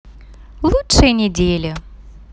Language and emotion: Russian, positive